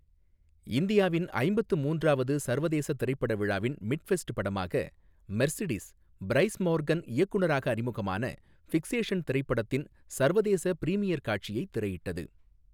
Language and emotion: Tamil, neutral